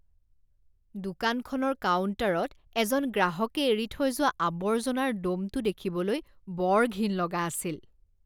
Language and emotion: Assamese, disgusted